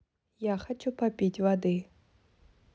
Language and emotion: Russian, neutral